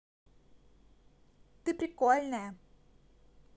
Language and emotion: Russian, positive